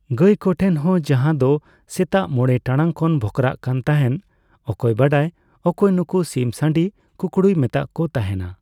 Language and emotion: Santali, neutral